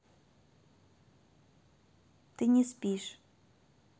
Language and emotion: Russian, neutral